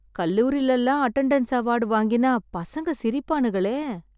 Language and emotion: Tamil, sad